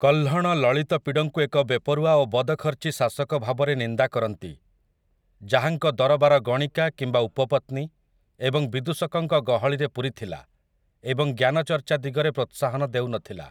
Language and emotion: Odia, neutral